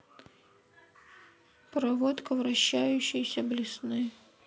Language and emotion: Russian, sad